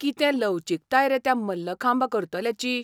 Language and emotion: Goan Konkani, surprised